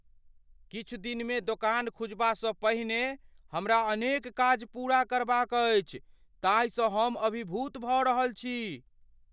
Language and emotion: Maithili, fearful